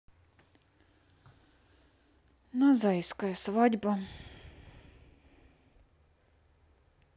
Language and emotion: Russian, sad